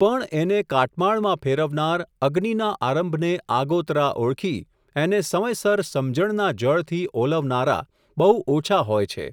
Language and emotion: Gujarati, neutral